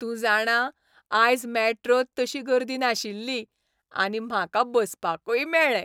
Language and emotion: Goan Konkani, happy